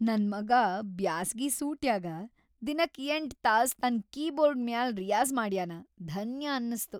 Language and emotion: Kannada, happy